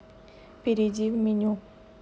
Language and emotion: Russian, neutral